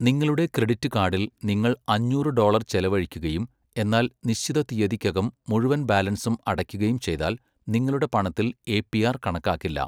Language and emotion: Malayalam, neutral